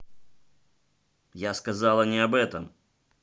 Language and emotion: Russian, angry